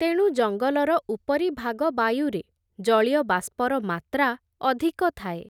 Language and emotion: Odia, neutral